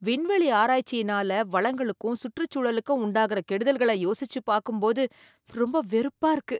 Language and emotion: Tamil, disgusted